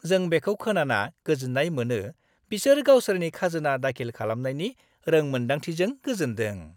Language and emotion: Bodo, happy